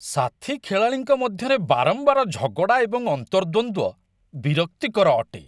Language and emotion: Odia, disgusted